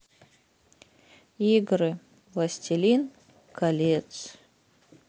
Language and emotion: Russian, sad